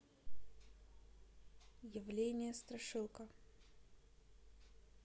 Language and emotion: Russian, neutral